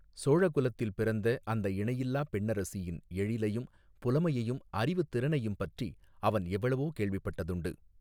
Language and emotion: Tamil, neutral